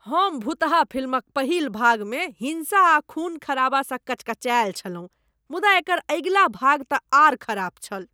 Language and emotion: Maithili, disgusted